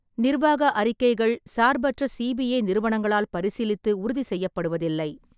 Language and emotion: Tamil, neutral